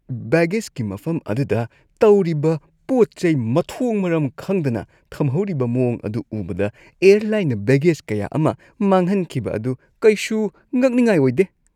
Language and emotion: Manipuri, disgusted